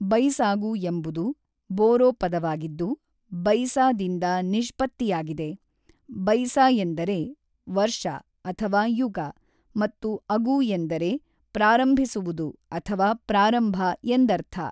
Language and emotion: Kannada, neutral